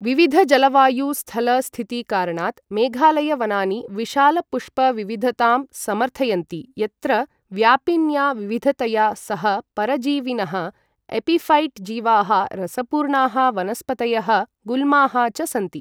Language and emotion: Sanskrit, neutral